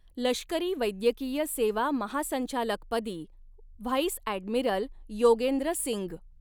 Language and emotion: Marathi, neutral